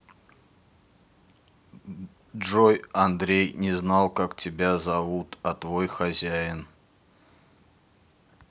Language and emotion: Russian, neutral